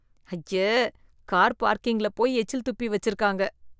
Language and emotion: Tamil, disgusted